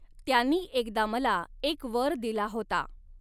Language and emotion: Marathi, neutral